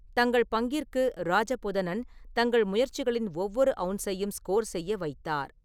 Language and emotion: Tamil, neutral